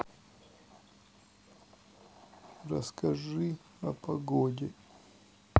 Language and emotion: Russian, sad